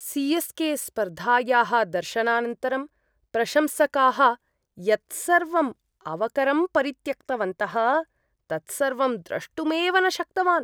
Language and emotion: Sanskrit, disgusted